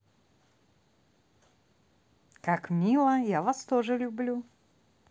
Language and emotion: Russian, positive